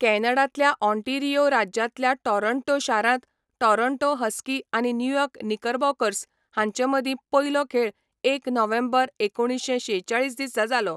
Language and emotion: Goan Konkani, neutral